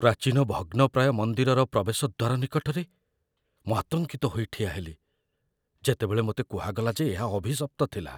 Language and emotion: Odia, fearful